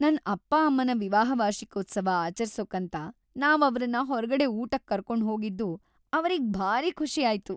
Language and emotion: Kannada, happy